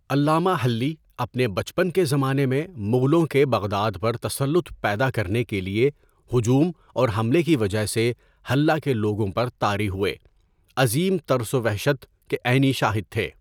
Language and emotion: Urdu, neutral